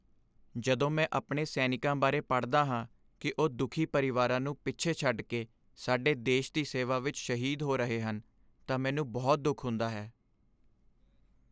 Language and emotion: Punjabi, sad